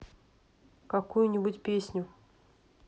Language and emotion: Russian, neutral